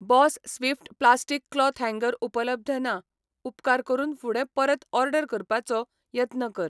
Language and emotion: Goan Konkani, neutral